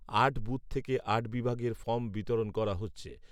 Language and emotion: Bengali, neutral